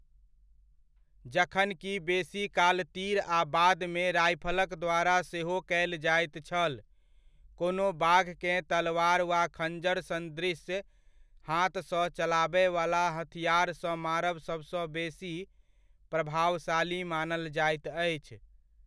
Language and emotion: Maithili, neutral